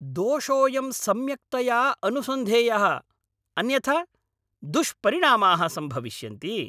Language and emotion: Sanskrit, angry